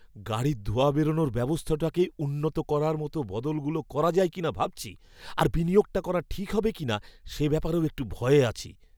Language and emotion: Bengali, fearful